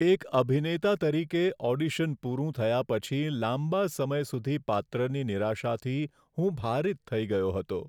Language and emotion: Gujarati, sad